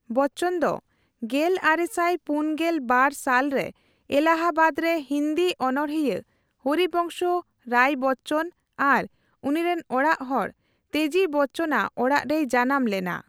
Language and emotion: Santali, neutral